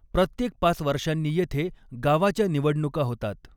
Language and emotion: Marathi, neutral